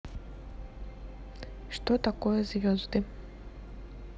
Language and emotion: Russian, neutral